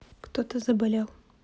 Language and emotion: Russian, neutral